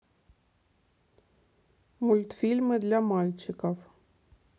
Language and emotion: Russian, neutral